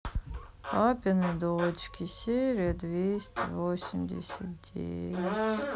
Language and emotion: Russian, sad